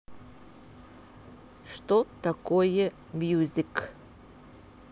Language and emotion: Russian, neutral